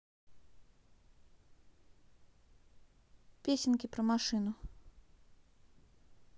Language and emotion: Russian, neutral